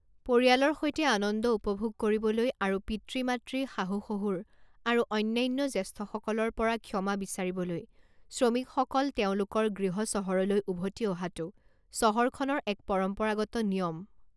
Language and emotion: Assamese, neutral